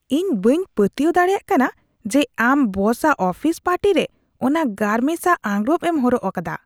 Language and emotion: Santali, disgusted